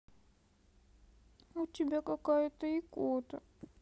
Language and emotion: Russian, sad